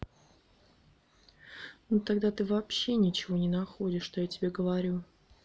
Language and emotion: Russian, neutral